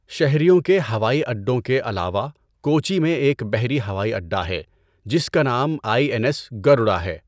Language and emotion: Urdu, neutral